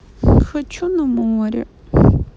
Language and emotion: Russian, sad